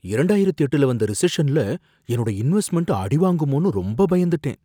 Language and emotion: Tamil, fearful